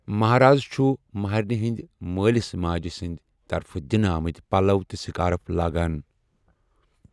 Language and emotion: Kashmiri, neutral